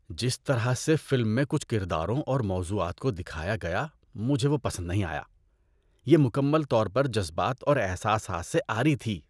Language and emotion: Urdu, disgusted